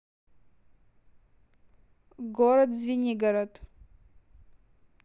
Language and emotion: Russian, neutral